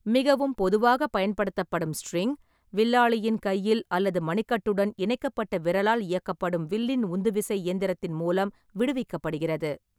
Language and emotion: Tamil, neutral